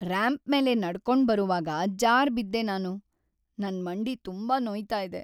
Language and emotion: Kannada, sad